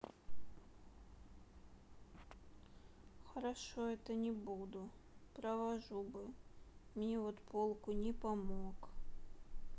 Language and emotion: Russian, sad